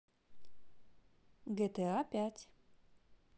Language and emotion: Russian, neutral